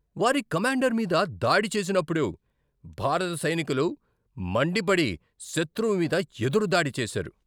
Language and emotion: Telugu, angry